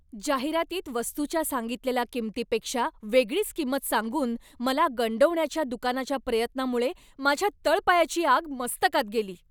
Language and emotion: Marathi, angry